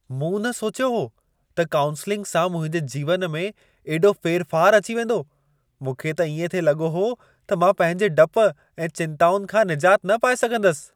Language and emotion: Sindhi, surprised